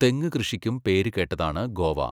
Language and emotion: Malayalam, neutral